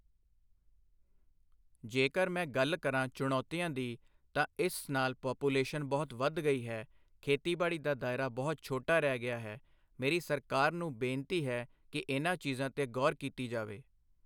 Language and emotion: Punjabi, neutral